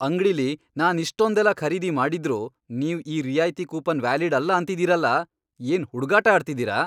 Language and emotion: Kannada, angry